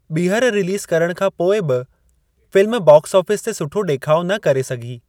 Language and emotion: Sindhi, neutral